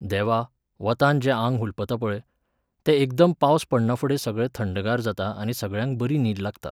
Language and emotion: Goan Konkani, neutral